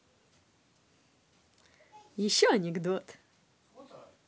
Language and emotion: Russian, positive